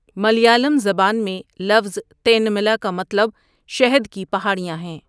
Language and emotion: Urdu, neutral